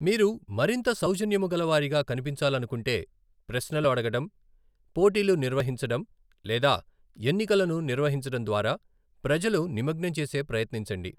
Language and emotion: Telugu, neutral